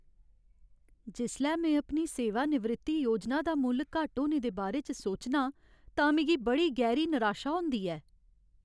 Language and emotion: Dogri, sad